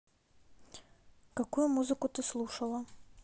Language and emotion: Russian, neutral